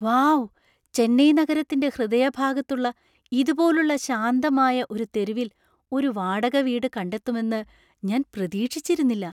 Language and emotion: Malayalam, surprised